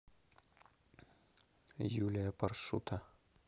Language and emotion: Russian, neutral